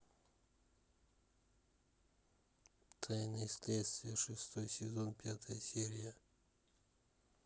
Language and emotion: Russian, neutral